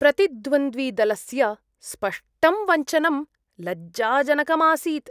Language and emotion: Sanskrit, disgusted